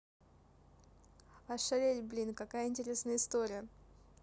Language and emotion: Russian, neutral